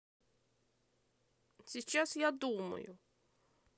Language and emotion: Russian, angry